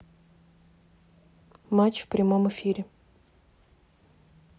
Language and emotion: Russian, neutral